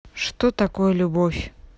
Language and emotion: Russian, neutral